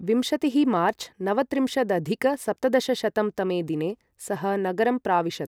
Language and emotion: Sanskrit, neutral